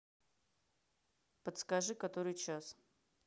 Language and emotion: Russian, neutral